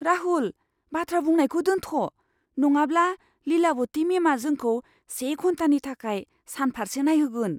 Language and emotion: Bodo, fearful